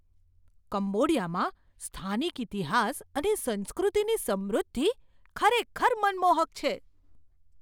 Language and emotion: Gujarati, surprised